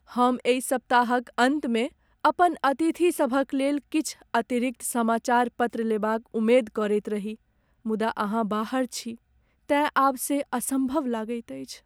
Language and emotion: Maithili, sad